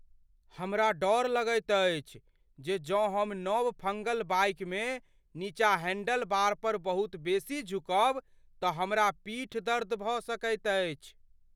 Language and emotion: Maithili, fearful